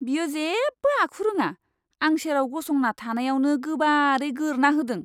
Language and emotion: Bodo, disgusted